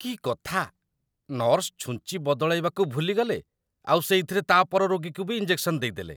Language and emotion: Odia, disgusted